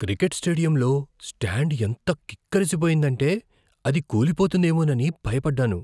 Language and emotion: Telugu, fearful